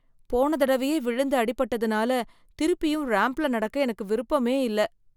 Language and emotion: Tamil, fearful